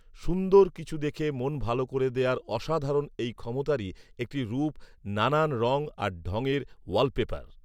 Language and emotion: Bengali, neutral